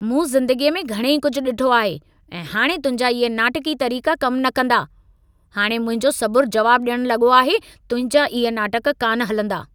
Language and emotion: Sindhi, angry